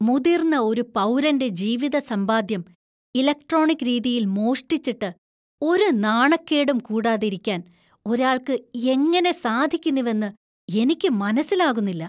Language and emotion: Malayalam, disgusted